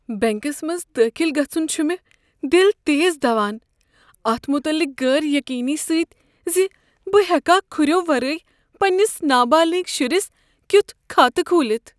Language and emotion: Kashmiri, fearful